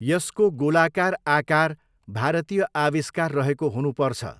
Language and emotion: Nepali, neutral